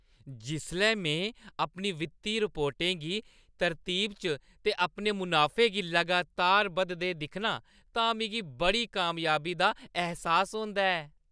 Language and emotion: Dogri, happy